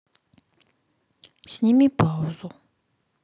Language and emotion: Russian, sad